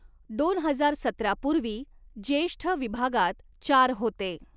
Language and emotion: Marathi, neutral